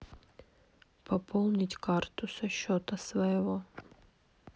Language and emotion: Russian, neutral